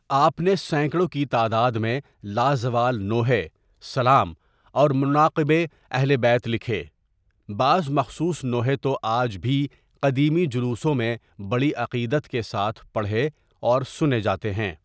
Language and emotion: Urdu, neutral